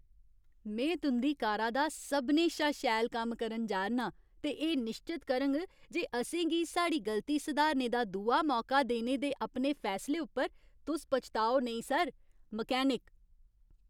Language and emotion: Dogri, happy